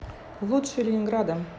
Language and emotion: Russian, neutral